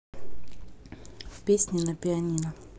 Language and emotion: Russian, neutral